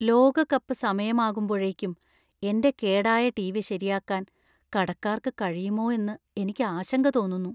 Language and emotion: Malayalam, fearful